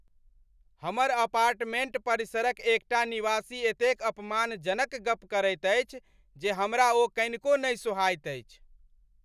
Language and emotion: Maithili, angry